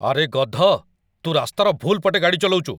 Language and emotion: Odia, angry